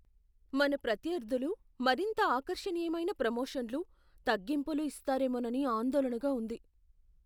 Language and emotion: Telugu, fearful